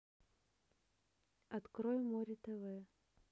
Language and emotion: Russian, neutral